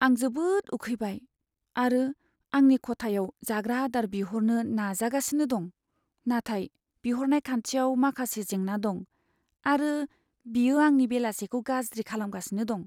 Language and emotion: Bodo, sad